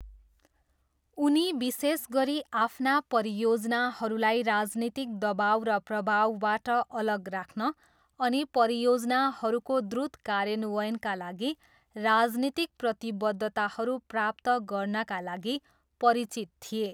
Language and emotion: Nepali, neutral